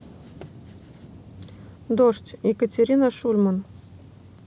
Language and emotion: Russian, neutral